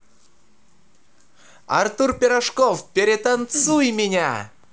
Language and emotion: Russian, positive